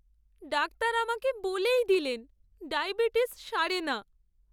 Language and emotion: Bengali, sad